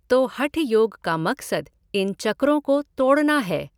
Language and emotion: Hindi, neutral